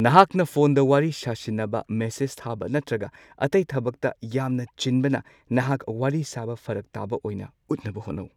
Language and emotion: Manipuri, neutral